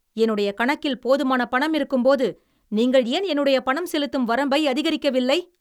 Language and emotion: Tamil, angry